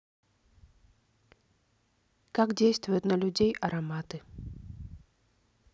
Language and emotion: Russian, neutral